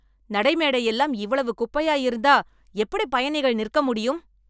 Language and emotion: Tamil, angry